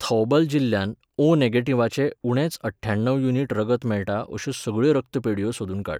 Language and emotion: Goan Konkani, neutral